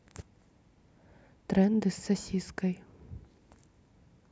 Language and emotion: Russian, neutral